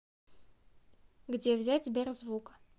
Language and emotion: Russian, neutral